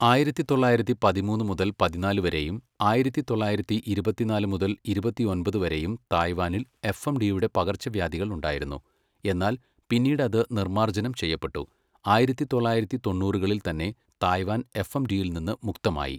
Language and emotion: Malayalam, neutral